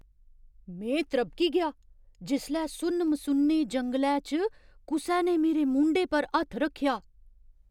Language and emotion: Dogri, surprised